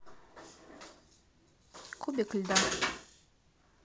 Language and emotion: Russian, neutral